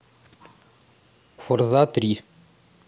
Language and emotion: Russian, neutral